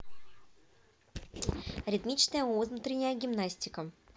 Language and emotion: Russian, positive